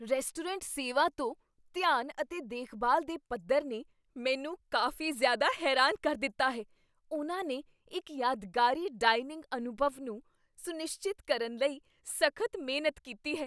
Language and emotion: Punjabi, surprised